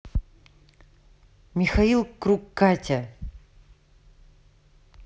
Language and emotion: Russian, neutral